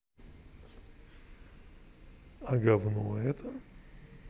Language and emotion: Russian, neutral